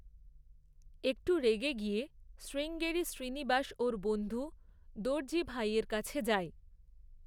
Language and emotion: Bengali, neutral